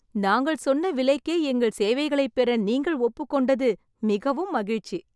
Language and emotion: Tamil, happy